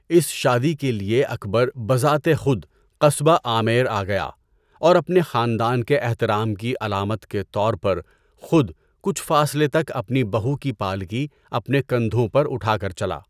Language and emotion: Urdu, neutral